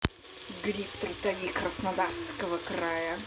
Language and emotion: Russian, angry